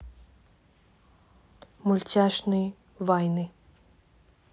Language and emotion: Russian, neutral